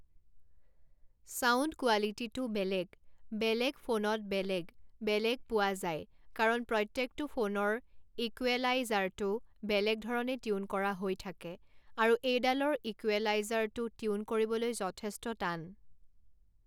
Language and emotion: Assamese, neutral